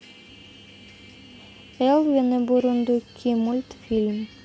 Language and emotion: Russian, neutral